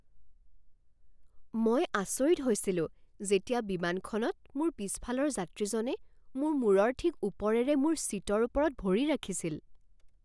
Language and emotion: Assamese, surprised